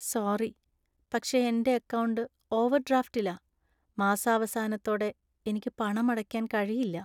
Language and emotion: Malayalam, sad